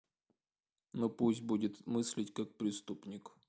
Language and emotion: Russian, neutral